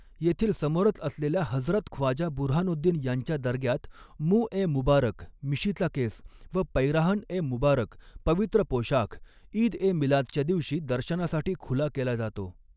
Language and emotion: Marathi, neutral